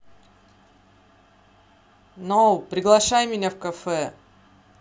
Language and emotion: Russian, neutral